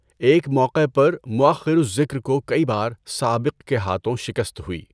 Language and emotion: Urdu, neutral